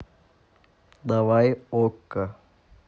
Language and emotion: Russian, neutral